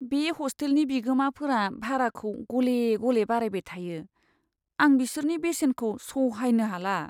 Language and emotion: Bodo, sad